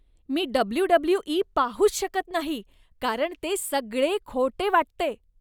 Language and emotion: Marathi, disgusted